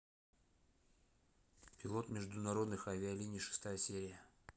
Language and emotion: Russian, neutral